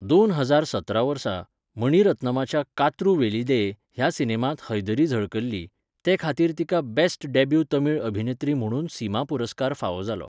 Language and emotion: Goan Konkani, neutral